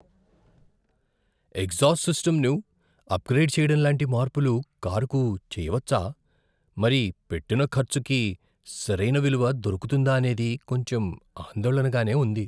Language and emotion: Telugu, fearful